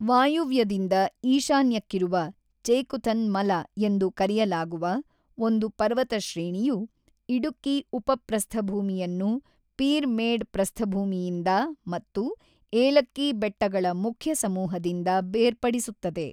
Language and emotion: Kannada, neutral